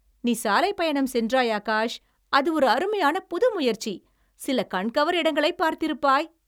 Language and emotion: Tamil, happy